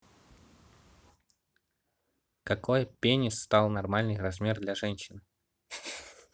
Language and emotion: Russian, neutral